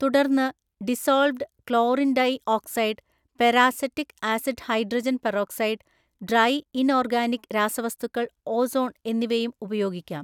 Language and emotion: Malayalam, neutral